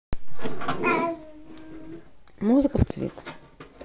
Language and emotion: Russian, neutral